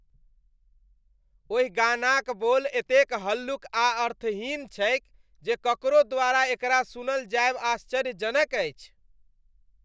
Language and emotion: Maithili, disgusted